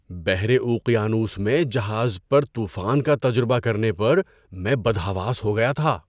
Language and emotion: Urdu, surprised